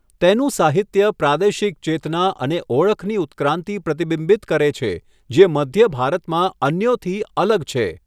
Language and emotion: Gujarati, neutral